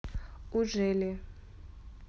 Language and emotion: Russian, neutral